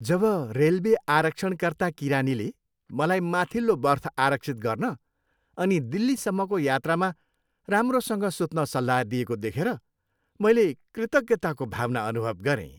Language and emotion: Nepali, happy